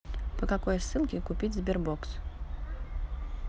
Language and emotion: Russian, neutral